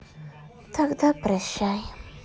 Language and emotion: Russian, sad